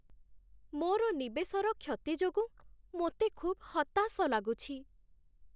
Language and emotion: Odia, sad